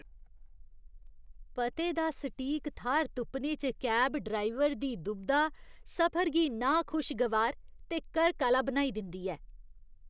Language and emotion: Dogri, disgusted